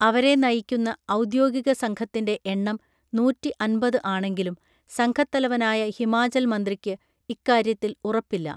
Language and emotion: Malayalam, neutral